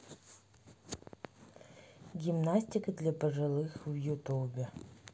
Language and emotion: Russian, neutral